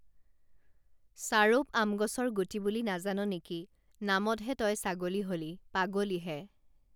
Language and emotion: Assamese, neutral